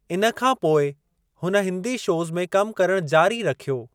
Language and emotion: Sindhi, neutral